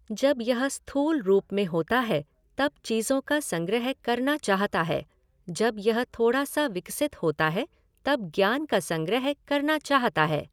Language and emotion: Hindi, neutral